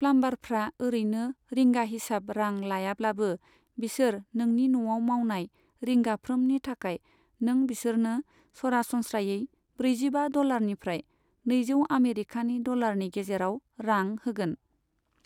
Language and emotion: Bodo, neutral